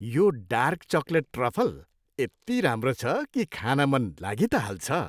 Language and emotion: Nepali, happy